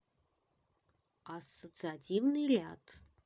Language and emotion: Russian, neutral